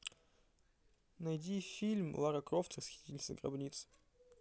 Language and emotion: Russian, neutral